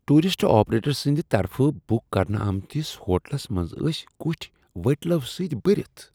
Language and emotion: Kashmiri, disgusted